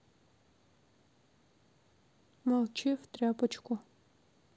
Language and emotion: Russian, sad